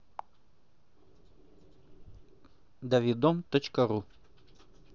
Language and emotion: Russian, neutral